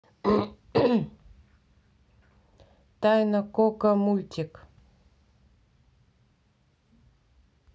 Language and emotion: Russian, neutral